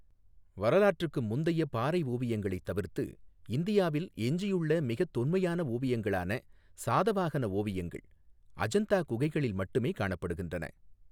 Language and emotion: Tamil, neutral